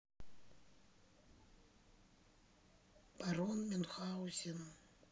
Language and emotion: Russian, neutral